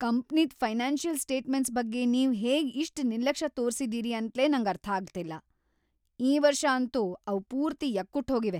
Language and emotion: Kannada, angry